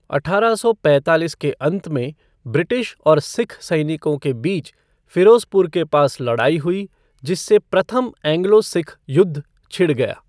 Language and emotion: Hindi, neutral